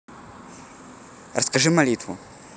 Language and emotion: Russian, neutral